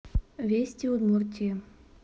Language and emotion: Russian, neutral